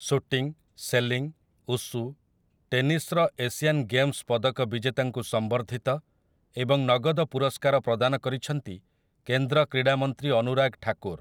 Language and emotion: Odia, neutral